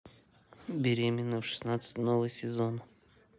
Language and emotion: Russian, neutral